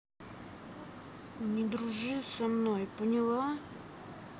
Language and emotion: Russian, neutral